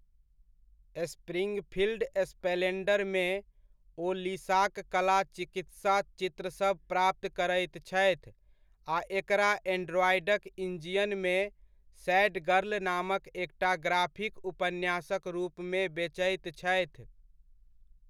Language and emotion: Maithili, neutral